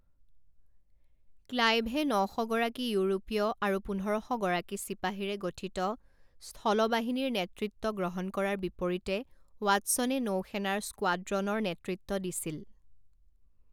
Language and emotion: Assamese, neutral